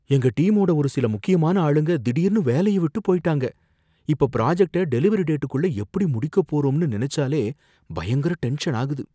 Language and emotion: Tamil, fearful